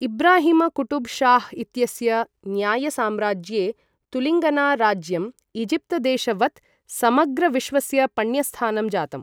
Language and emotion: Sanskrit, neutral